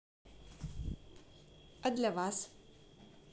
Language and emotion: Russian, positive